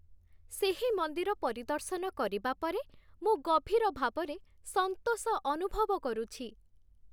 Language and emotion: Odia, happy